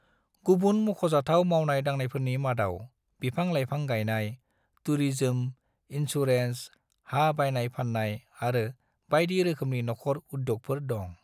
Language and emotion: Bodo, neutral